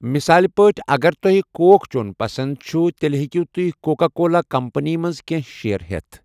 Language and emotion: Kashmiri, neutral